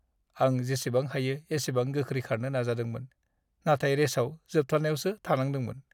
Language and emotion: Bodo, sad